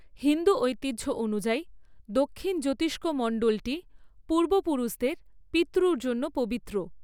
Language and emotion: Bengali, neutral